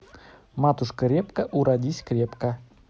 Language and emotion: Russian, neutral